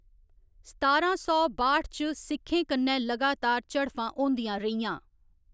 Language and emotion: Dogri, neutral